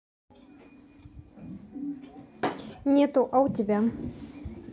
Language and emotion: Russian, neutral